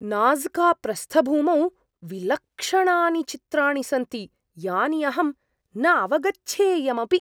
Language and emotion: Sanskrit, surprised